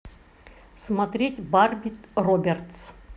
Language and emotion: Russian, neutral